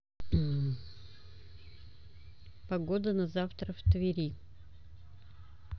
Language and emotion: Russian, neutral